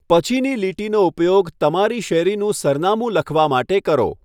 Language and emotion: Gujarati, neutral